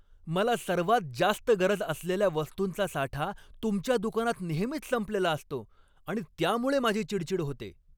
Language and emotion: Marathi, angry